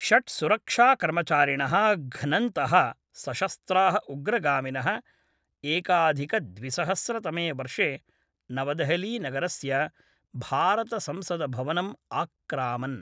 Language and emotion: Sanskrit, neutral